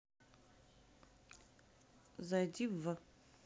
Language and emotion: Russian, neutral